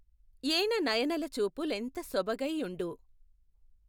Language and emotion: Telugu, neutral